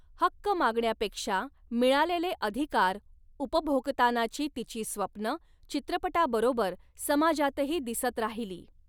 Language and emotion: Marathi, neutral